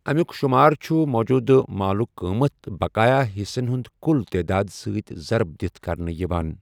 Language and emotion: Kashmiri, neutral